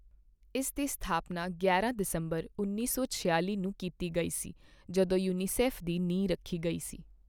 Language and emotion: Punjabi, neutral